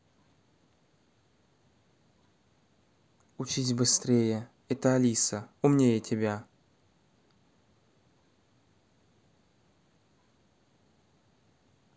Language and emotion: Russian, neutral